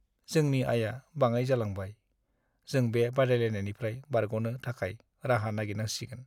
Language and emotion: Bodo, sad